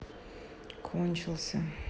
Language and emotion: Russian, sad